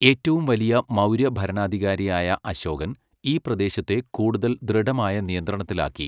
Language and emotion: Malayalam, neutral